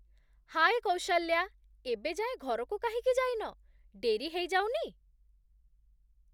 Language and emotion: Odia, surprised